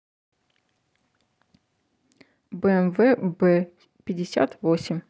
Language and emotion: Russian, neutral